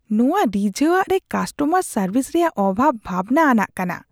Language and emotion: Santali, disgusted